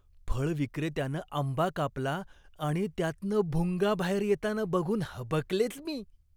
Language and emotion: Marathi, disgusted